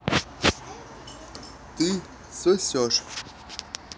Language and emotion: Russian, neutral